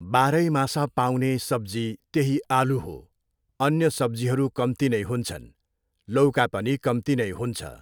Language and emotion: Nepali, neutral